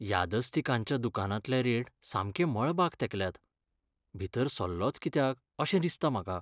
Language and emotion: Goan Konkani, sad